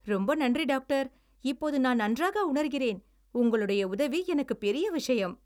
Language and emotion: Tamil, happy